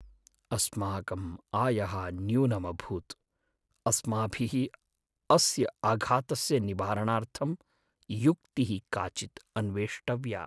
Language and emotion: Sanskrit, sad